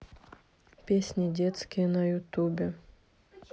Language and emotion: Russian, neutral